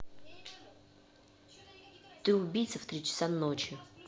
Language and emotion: Russian, angry